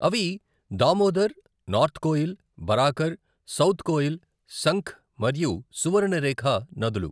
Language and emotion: Telugu, neutral